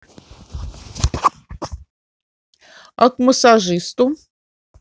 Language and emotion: Russian, positive